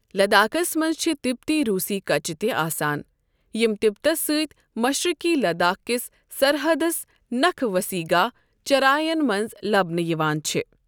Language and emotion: Kashmiri, neutral